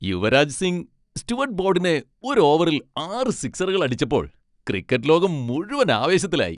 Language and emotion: Malayalam, happy